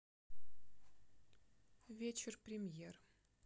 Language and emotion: Russian, neutral